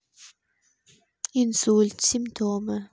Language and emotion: Russian, neutral